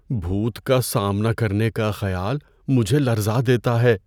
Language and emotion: Urdu, fearful